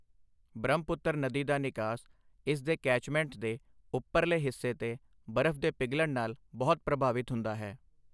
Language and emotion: Punjabi, neutral